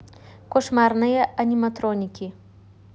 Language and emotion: Russian, neutral